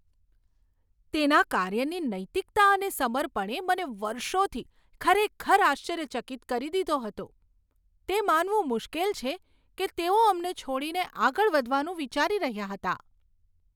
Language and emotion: Gujarati, surprised